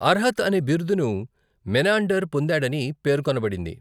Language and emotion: Telugu, neutral